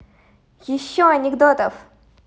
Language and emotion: Russian, positive